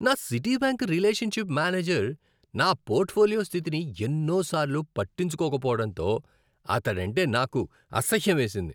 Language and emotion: Telugu, disgusted